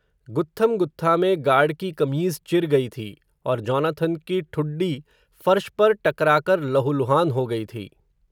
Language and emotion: Hindi, neutral